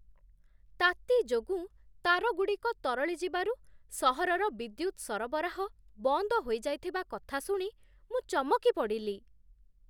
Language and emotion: Odia, surprised